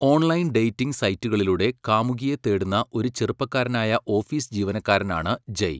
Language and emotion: Malayalam, neutral